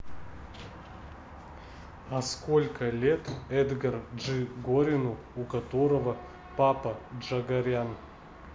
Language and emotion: Russian, neutral